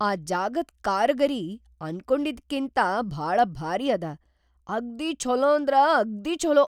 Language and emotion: Kannada, surprised